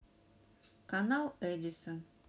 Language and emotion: Russian, neutral